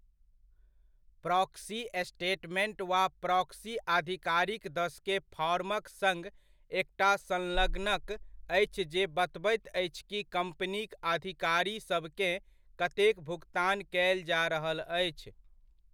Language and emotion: Maithili, neutral